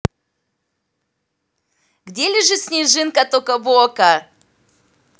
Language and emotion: Russian, positive